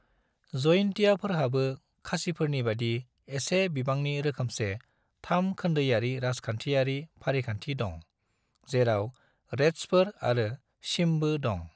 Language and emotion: Bodo, neutral